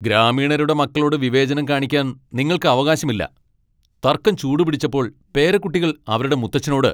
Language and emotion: Malayalam, angry